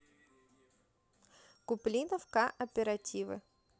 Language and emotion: Russian, neutral